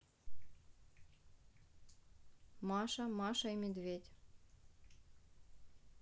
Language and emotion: Russian, neutral